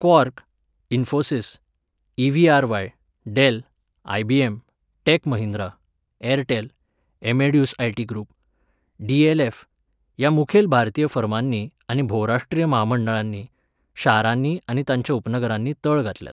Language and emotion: Goan Konkani, neutral